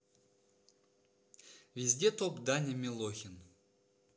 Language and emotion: Russian, neutral